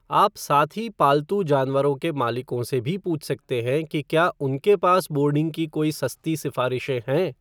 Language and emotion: Hindi, neutral